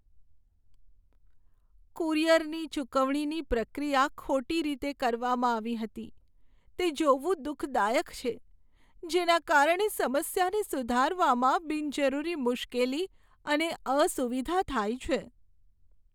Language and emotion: Gujarati, sad